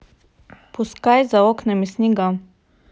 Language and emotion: Russian, neutral